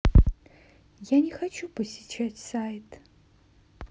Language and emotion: Russian, sad